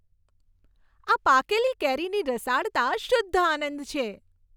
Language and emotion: Gujarati, happy